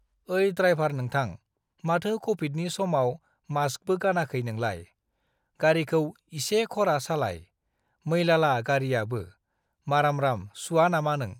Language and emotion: Bodo, neutral